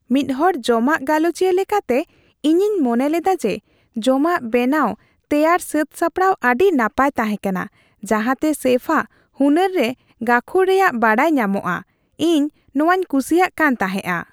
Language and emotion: Santali, happy